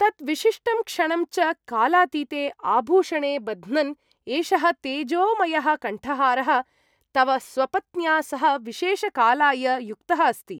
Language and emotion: Sanskrit, happy